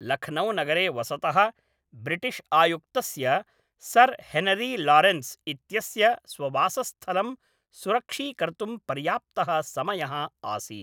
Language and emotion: Sanskrit, neutral